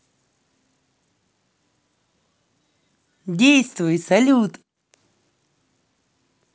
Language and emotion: Russian, positive